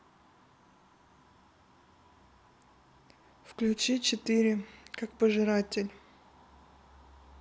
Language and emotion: Russian, neutral